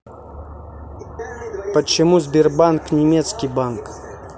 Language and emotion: Russian, neutral